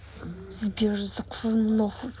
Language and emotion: Russian, angry